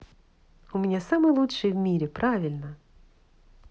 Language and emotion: Russian, positive